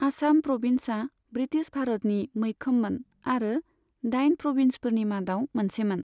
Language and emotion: Bodo, neutral